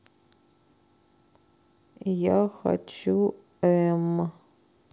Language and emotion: Russian, neutral